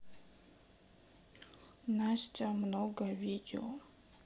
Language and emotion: Russian, sad